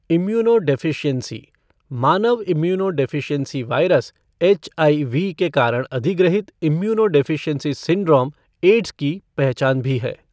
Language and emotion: Hindi, neutral